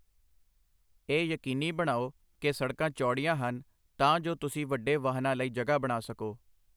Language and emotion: Punjabi, neutral